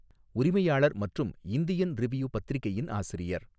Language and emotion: Tamil, neutral